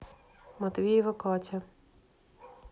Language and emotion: Russian, neutral